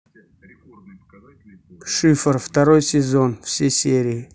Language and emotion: Russian, neutral